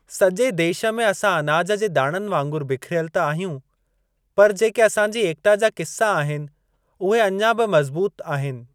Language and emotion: Sindhi, neutral